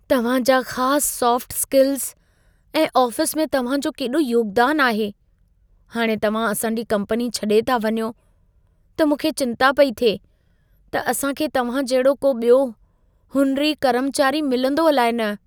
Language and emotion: Sindhi, fearful